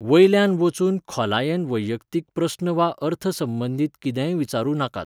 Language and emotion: Goan Konkani, neutral